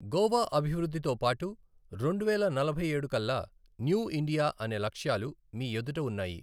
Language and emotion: Telugu, neutral